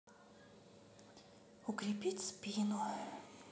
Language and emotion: Russian, sad